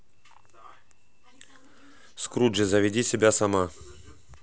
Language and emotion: Russian, neutral